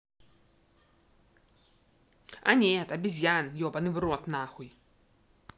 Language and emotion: Russian, angry